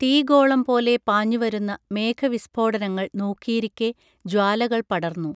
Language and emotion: Malayalam, neutral